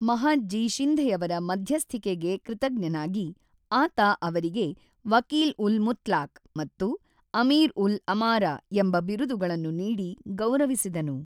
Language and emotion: Kannada, neutral